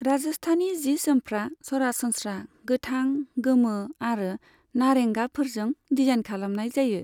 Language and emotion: Bodo, neutral